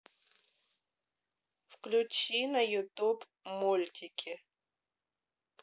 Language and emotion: Russian, neutral